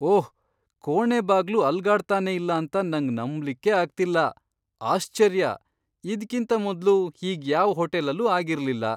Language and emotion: Kannada, surprised